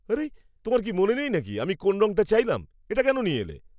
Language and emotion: Bengali, angry